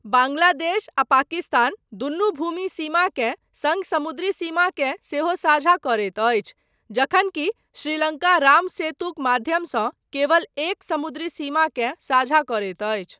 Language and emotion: Maithili, neutral